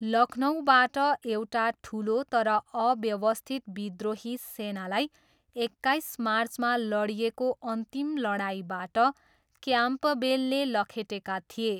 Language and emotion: Nepali, neutral